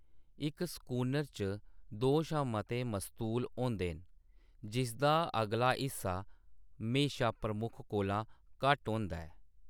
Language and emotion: Dogri, neutral